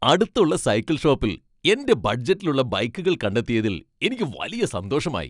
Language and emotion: Malayalam, happy